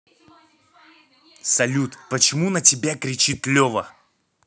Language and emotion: Russian, angry